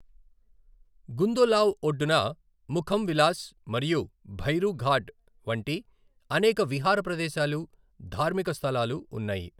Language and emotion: Telugu, neutral